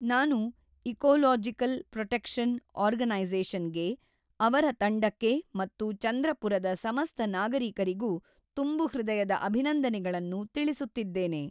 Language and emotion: Kannada, neutral